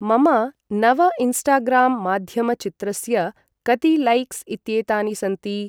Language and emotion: Sanskrit, neutral